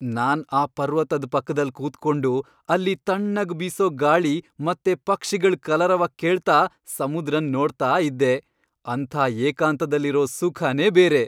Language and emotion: Kannada, happy